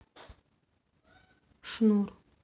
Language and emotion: Russian, neutral